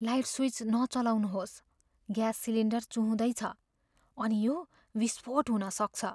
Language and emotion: Nepali, fearful